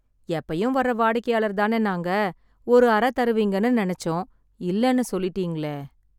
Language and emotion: Tamil, sad